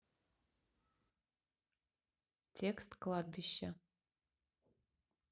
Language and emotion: Russian, neutral